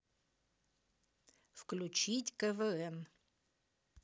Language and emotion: Russian, neutral